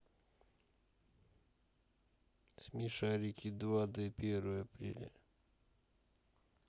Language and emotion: Russian, neutral